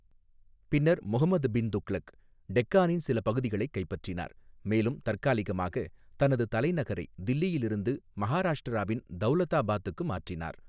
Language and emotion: Tamil, neutral